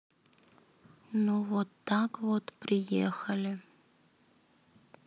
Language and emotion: Russian, neutral